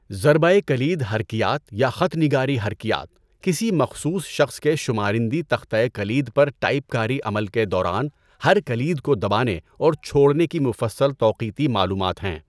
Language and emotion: Urdu, neutral